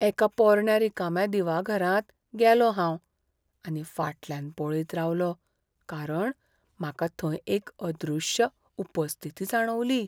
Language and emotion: Goan Konkani, fearful